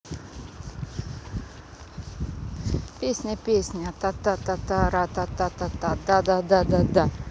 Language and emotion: Russian, neutral